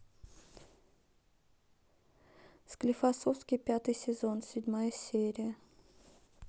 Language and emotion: Russian, neutral